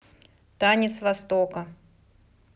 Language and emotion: Russian, neutral